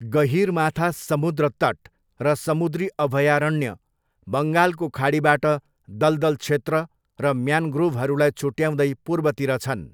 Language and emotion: Nepali, neutral